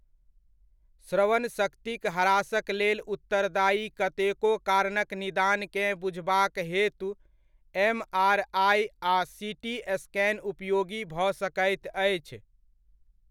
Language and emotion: Maithili, neutral